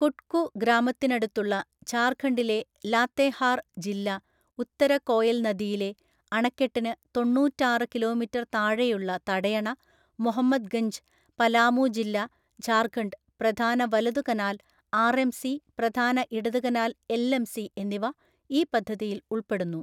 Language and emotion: Malayalam, neutral